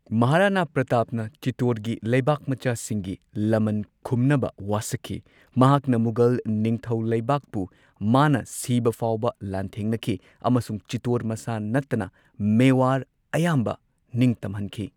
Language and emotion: Manipuri, neutral